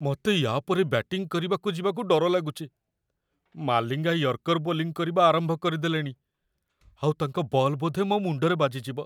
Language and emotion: Odia, fearful